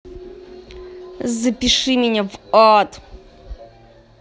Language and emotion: Russian, angry